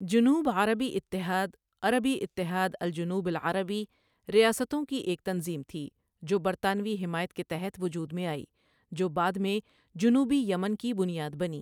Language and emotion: Urdu, neutral